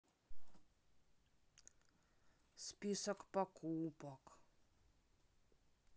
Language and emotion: Russian, sad